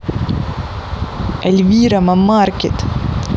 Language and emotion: Russian, neutral